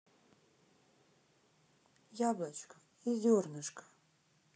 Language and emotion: Russian, sad